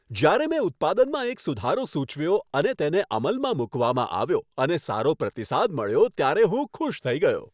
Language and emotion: Gujarati, happy